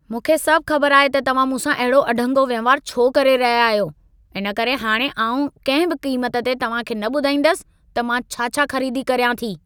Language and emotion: Sindhi, angry